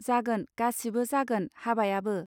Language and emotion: Bodo, neutral